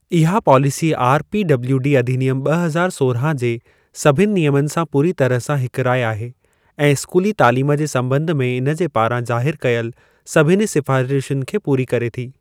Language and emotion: Sindhi, neutral